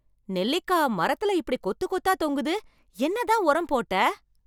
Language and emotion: Tamil, surprised